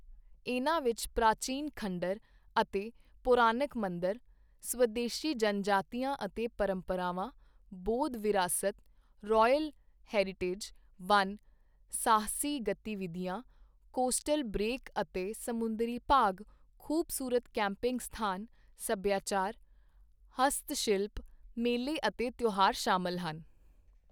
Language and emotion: Punjabi, neutral